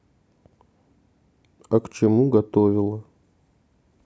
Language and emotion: Russian, neutral